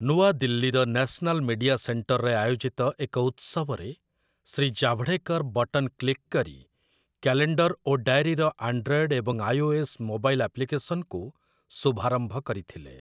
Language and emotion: Odia, neutral